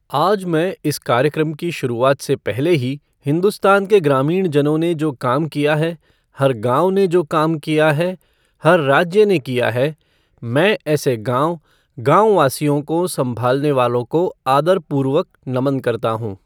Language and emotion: Hindi, neutral